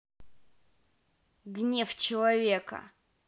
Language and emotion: Russian, angry